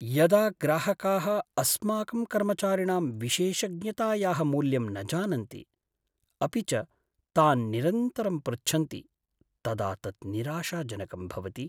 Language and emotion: Sanskrit, sad